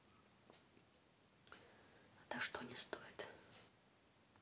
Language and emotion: Russian, neutral